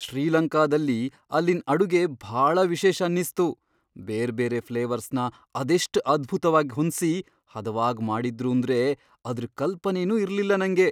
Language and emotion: Kannada, surprised